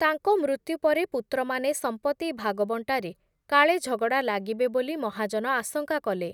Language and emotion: Odia, neutral